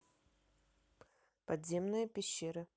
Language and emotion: Russian, neutral